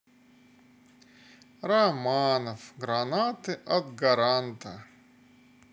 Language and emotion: Russian, sad